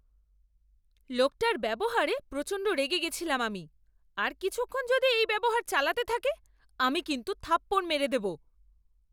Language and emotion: Bengali, angry